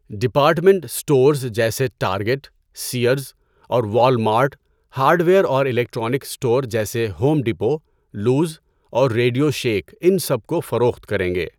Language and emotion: Urdu, neutral